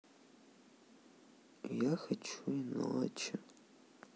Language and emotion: Russian, sad